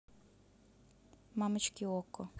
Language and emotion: Russian, neutral